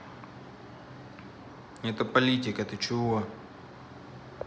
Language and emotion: Russian, neutral